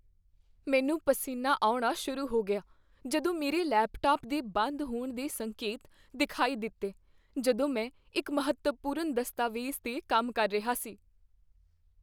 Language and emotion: Punjabi, fearful